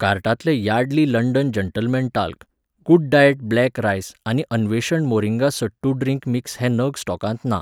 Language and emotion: Goan Konkani, neutral